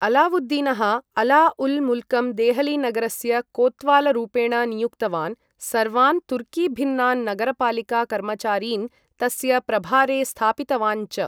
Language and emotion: Sanskrit, neutral